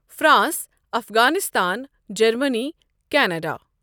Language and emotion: Kashmiri, neutral